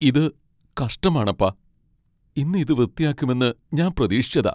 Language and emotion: Malayalam, sad